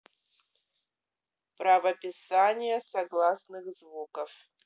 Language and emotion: Russian, neutral